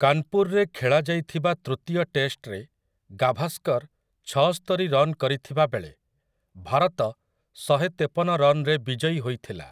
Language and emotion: Odia, neutral